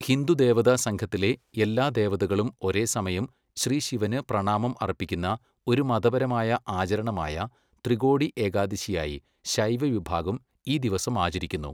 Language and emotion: Malayalam, neutral